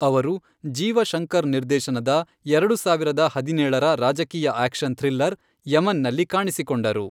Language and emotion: Kannada, neutral